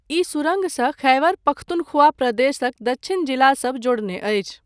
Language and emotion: Maithili, neutral